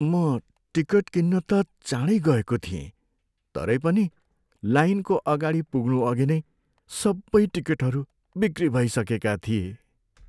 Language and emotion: Nepali, sad